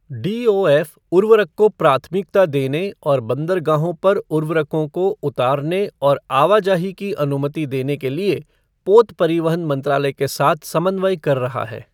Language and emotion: Hindi, neutral